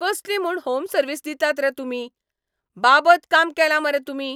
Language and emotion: Goan Konkani, angry